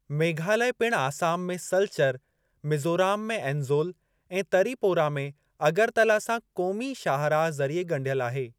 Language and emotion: Sindhi, neutral